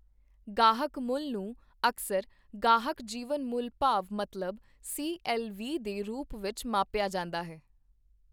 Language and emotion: Punjabi, neutral